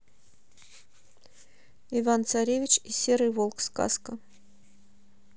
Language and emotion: Russian, neutral